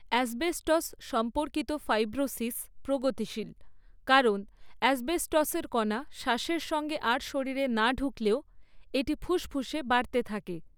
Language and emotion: Bengali, neutral